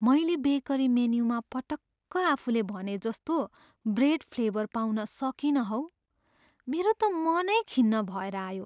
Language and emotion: Nepali, sad